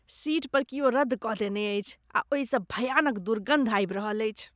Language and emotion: Maithili, disgusted